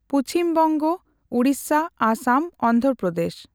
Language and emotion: Santali, neutral